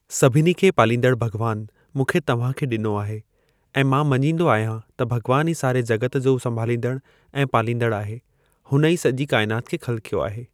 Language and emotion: Sindhi, neutral